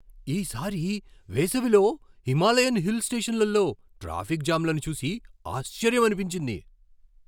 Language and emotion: Telugu, surprised